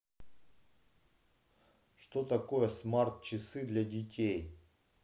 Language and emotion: Russian, neutral